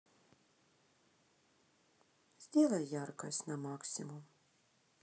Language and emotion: Russian, sad